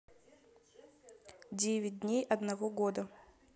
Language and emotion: Russian, neutral